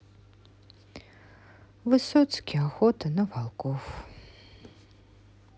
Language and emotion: Russian, sad